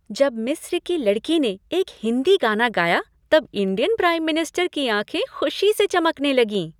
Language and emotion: Hindi, happy